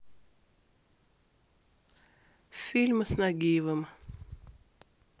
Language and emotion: Russian, neutral